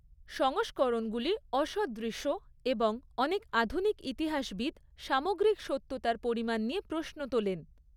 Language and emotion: Bengali, neutral